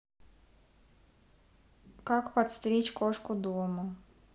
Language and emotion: Russian, neutral